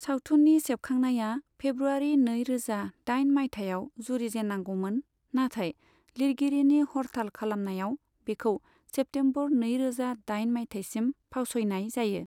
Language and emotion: Bodo, neutral